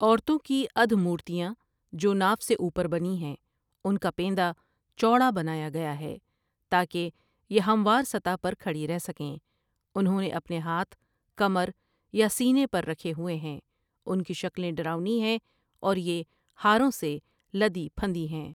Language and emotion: Urdu, neutral